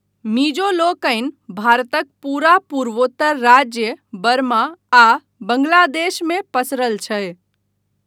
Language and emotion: Maithili, neutral